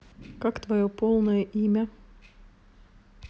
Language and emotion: Russian, neutral